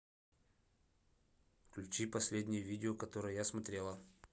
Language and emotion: Russian, neutral